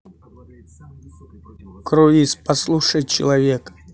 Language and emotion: Russian, neutral